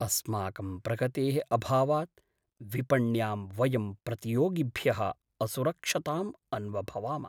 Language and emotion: Sanskrit, sad